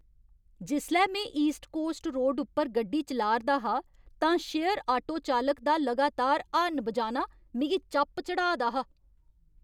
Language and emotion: Dogri, angry